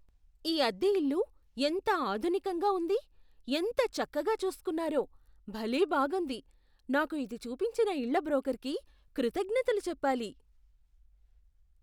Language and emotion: Telugu, surprised